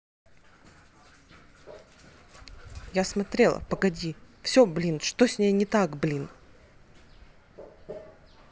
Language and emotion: Russian, angry